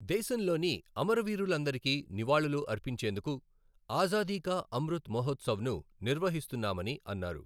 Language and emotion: Telugu, neutral